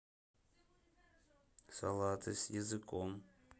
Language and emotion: Russian, neutral